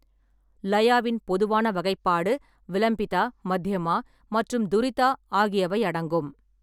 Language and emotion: Tamil, neutral